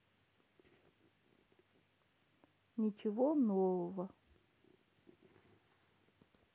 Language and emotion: Russian, sad